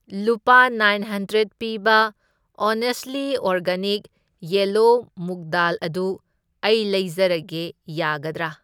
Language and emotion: Manipuri, neutral